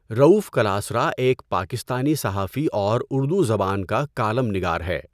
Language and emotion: Urdu, neutral